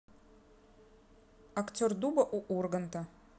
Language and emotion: Russian, neutral